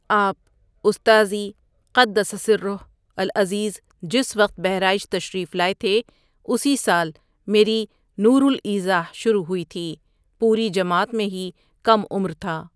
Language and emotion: Urdu, neutral